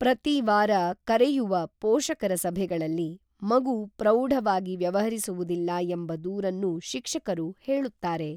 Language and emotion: Kannada, neutral